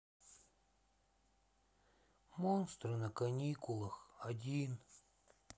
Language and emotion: Russian, sad